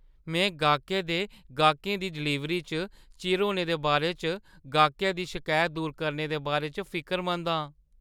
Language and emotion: Dogri, fearful